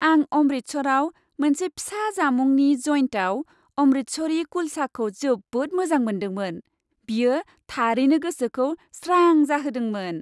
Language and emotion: Bodo, happy